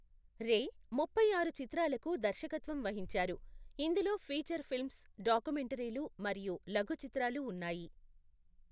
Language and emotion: Telugu, neutral